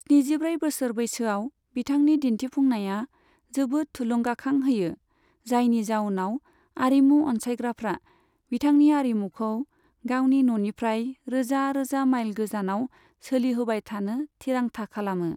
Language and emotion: Bodo, neutral